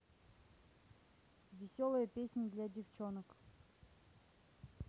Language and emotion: Russian, neutral